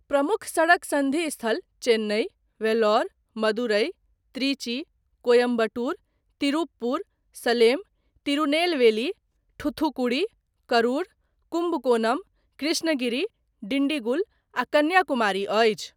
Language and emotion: Maithili, neutral